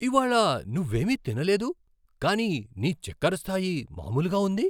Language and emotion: Telugu, surprised